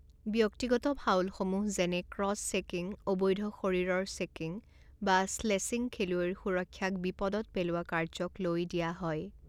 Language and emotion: Assamese, neutral